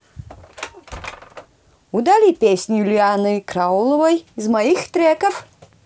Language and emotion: Russian, positive